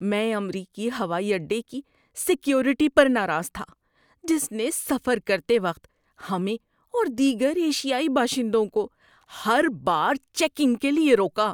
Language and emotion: Urdu, disgusted